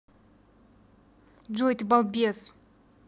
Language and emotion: Russian, angry